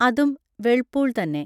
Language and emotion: Malayalam, neutral